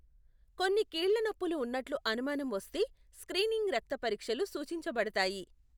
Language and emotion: Telugu, neutral